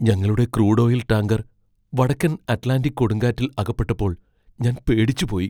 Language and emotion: Malayalam, fearful